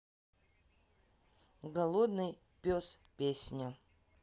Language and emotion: Russian, sad